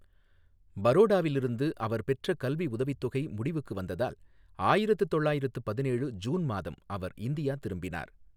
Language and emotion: Tamil, neutral